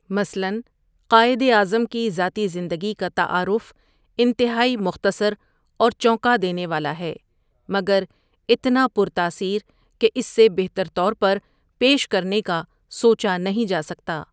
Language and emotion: Urdu, neutral